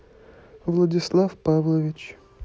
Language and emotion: Russian, neutral